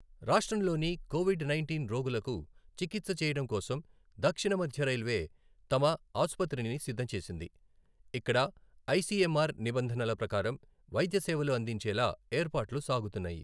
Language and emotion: Telugu, neutral